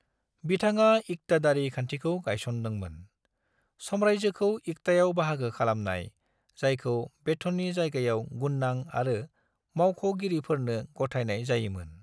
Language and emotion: Bodo, neutral